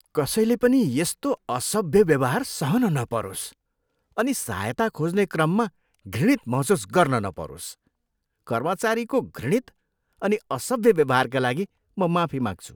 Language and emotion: Nepali, disgusted